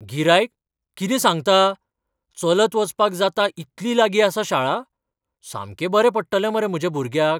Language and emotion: Goan Konkani, surprised